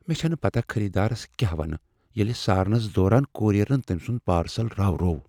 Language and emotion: Kashmiri, fearful